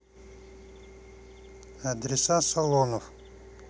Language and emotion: Russian, neutral